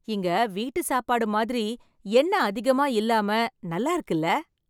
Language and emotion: Tamil, happy